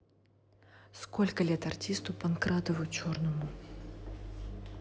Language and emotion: Russian, neutral